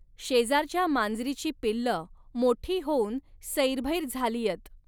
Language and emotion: Marathi, neutral